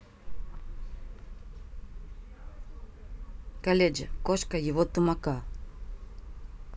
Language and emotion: Russian, neutral